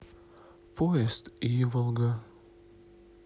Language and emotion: Russian, sad